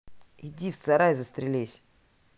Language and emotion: Russian, neutral